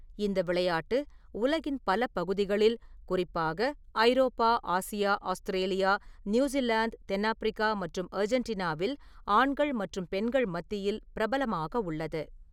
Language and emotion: Tamil, neutral